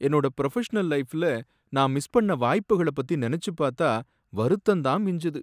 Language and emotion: Tamil, sad